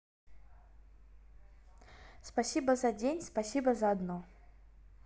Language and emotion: Russian, neutral